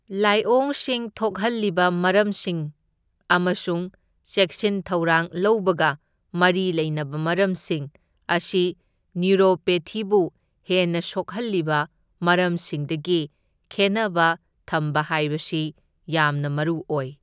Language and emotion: Manipuri, neutral